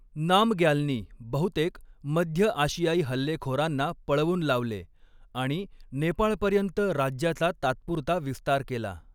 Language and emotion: Marathi, neutral